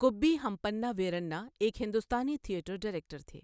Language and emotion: Urdu, neutral